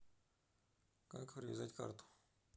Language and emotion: Russian, neutral